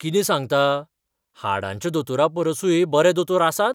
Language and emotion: Goan Konkani, surprised